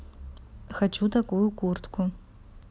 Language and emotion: Russian, neutral